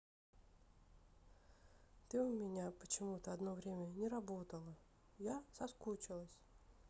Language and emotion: Russian, sad